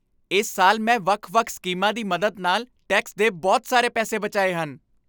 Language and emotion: Punjabi, happy